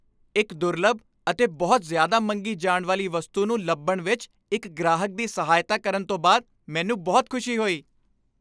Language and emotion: Punjabi, happy